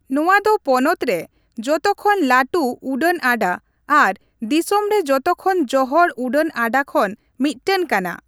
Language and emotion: Santali, neutral